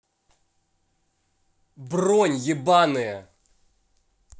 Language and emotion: Russian, angry